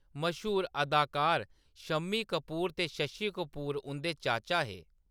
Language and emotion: Dogri, neutral